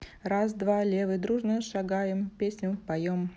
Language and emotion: Russian, neutral